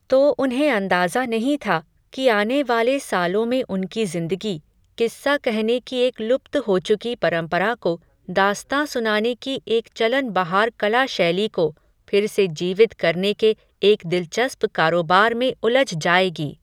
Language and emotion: Hindi, neutral